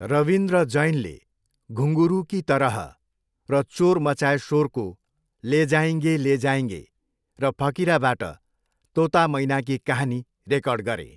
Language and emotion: Nepali, neutral